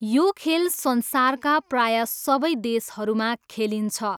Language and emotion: Nepali, neutral